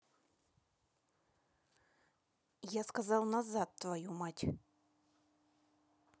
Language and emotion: Russian, angry